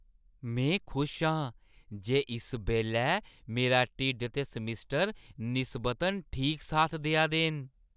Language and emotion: Dogri, happy